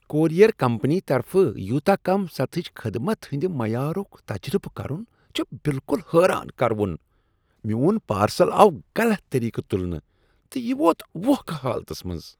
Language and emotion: Kashmiri, disgusted